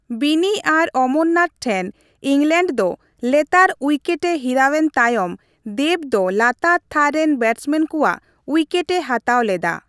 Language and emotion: Santali, neutral